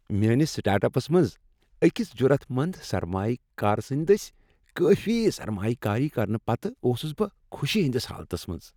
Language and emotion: Kashmiri, happy